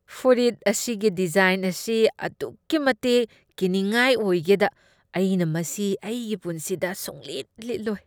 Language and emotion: Manipuri, disgusted